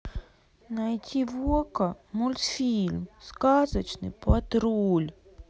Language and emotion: Russian, sad